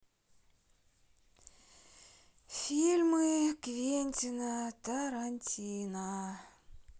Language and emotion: Russian, sad